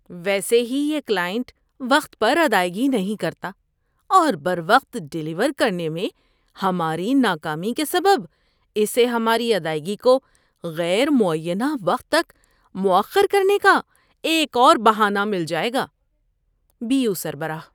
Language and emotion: Urdu, disgusted